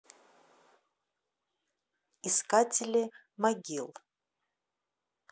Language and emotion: Russian, neutral